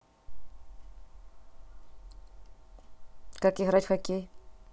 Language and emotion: Russian, neutral